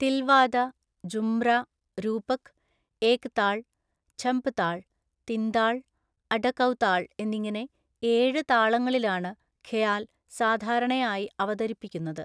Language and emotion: Malayalam, neutral